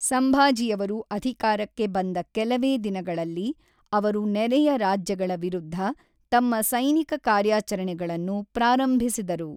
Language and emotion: Kannada, neutral